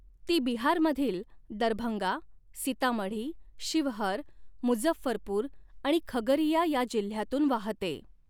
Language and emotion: Marathi, neutral